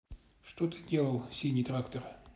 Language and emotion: Russian, neutral